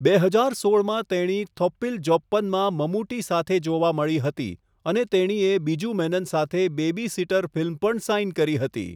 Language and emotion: Gujarati, neutral